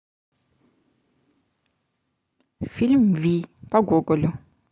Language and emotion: Russian, neutral